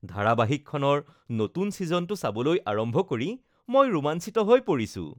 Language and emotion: Assamese, happy